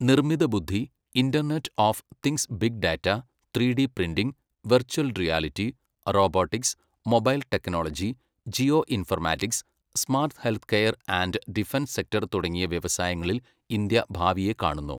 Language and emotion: Malayalam, neutral